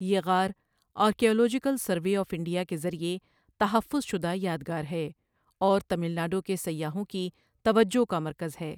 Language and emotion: Urdu, neutral